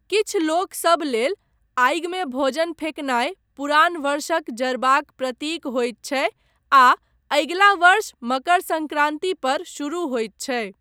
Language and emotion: Maithili, neutral